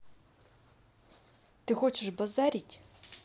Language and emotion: Russian, angry